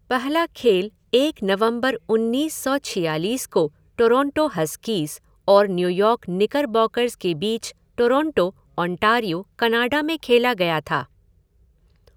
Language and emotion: Hindi, neutral